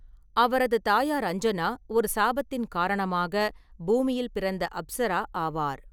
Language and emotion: Tamil, neutral